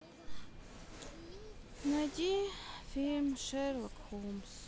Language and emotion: Russian, sad